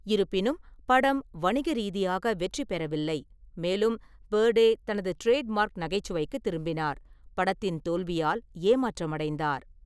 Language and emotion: Tamil, neutral